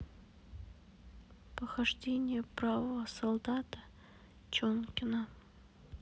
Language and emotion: Russian, sad